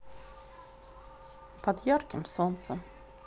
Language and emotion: Russian, neutral